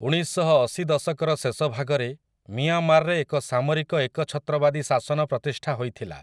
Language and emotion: Odia, neutral